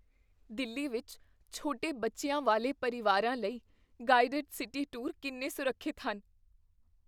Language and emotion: Punjabi, fearful